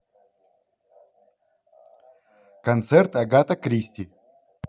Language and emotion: Russian, positive